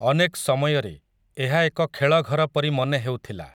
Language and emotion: Odia, neutral